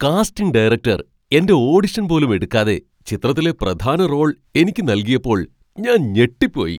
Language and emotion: Malayalam, surprised